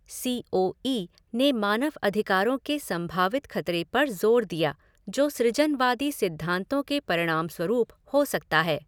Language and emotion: Hindi, neutral